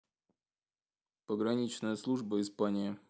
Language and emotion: Russian, neutral